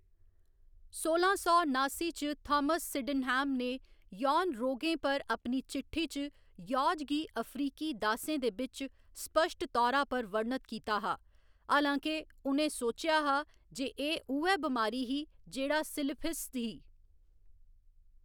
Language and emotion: Dogri, neutral